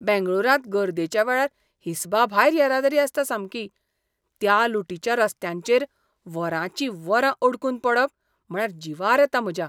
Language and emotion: Goan Konkani, disgusted